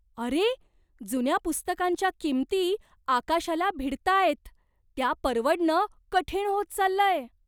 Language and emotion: Marathi, surprised